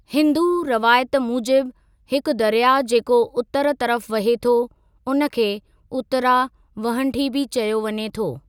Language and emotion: Sindhi, neutral